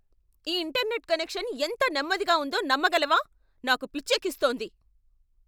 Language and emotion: Telugu, angry